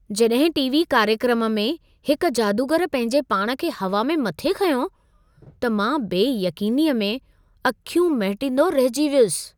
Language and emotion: Sindhi, surprised